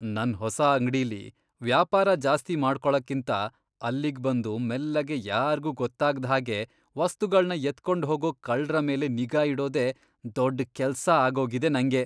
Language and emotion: Kannada, disgusted